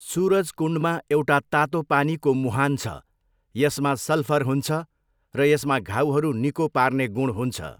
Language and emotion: Nepali, neutral